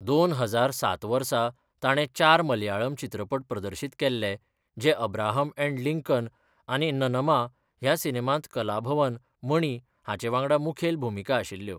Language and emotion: Goan Konkani, neutral